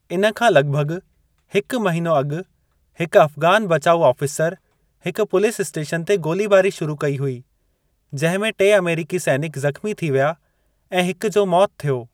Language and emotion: Sindhi, neutral